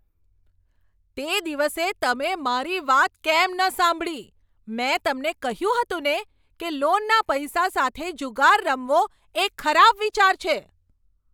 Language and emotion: Gujarati, angry